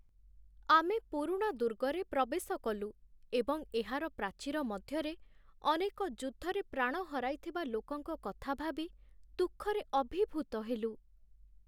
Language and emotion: Odia, sad